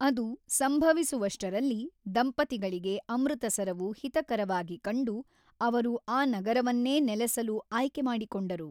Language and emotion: Kannada, neutral